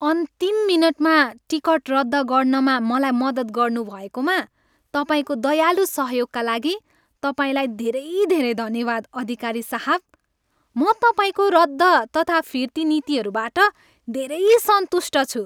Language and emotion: Nepali, happy